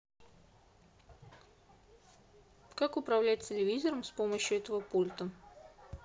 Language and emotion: Russian, neutral